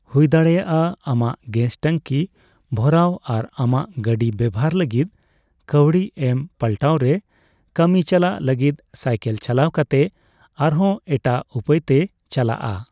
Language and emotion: Santali, neutral